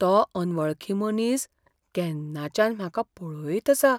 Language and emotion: Goan Konkani, fearful